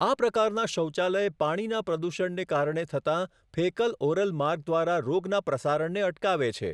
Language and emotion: Gujarati, neutral